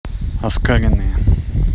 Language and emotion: Russian, neutral